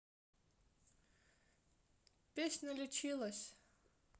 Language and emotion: Russian, neutral